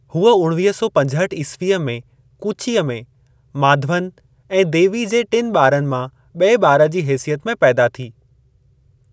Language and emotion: Sindhi, neutral